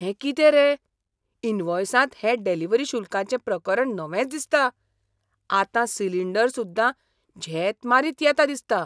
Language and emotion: Goan Konkani, surprised